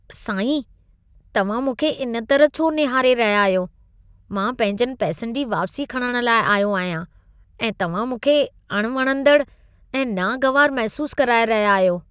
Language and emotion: Sindhi, disgusted